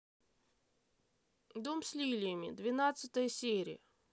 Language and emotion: Russian, neutral